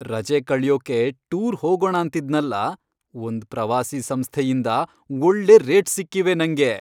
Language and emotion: Kannada, happy